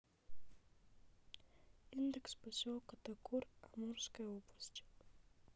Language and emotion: Russian, neutral